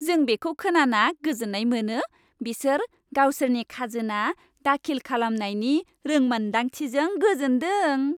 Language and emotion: Bodo, happy